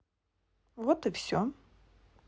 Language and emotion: Russian, neutral